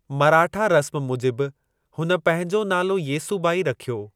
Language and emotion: Sindhi, neutral